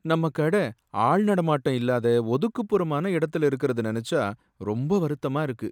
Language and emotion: Tamil, sad